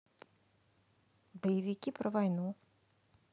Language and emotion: Russian, neutral